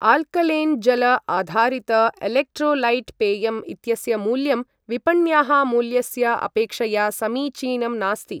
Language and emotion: Sanskrit, neutral